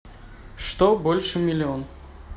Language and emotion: Russian, neutral